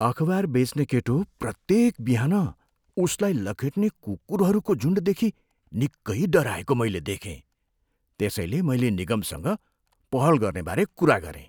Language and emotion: Nepali, fearful